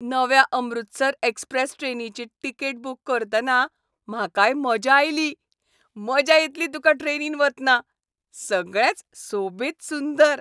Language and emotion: Goan Konkani, happy